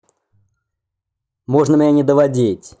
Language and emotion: Russian, angry